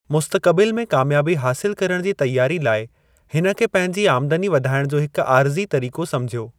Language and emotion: Sindhi, neutral